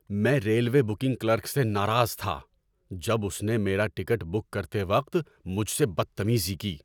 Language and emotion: Urdu, angry